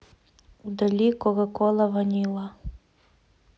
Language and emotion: Russian, neutral